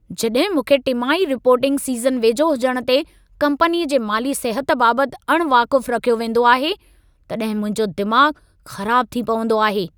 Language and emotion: Sindhi, angry